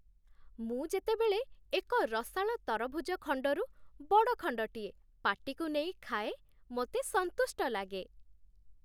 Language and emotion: Odia, happy